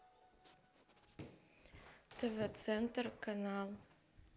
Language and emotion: Russian, neutral